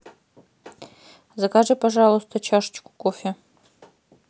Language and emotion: Russian, neutral